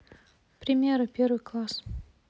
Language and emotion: Russian, neutral